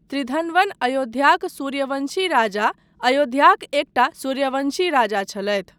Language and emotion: Maithili, neutral